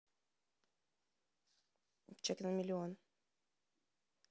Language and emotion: Russian, neutral